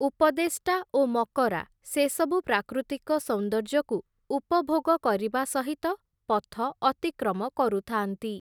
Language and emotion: Odia, neutral